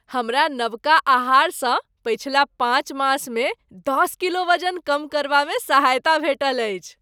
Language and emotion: Maithili, happy